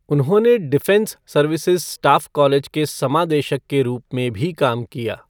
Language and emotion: Hindi, neutral